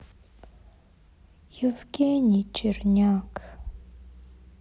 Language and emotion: Russian, sad